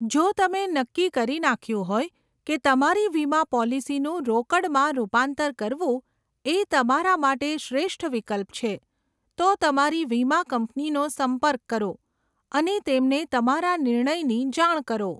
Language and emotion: Gujarati, neutral